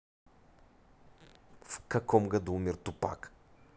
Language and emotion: Russian, neutral